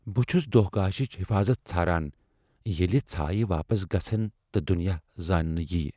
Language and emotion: Kashmiri, fearful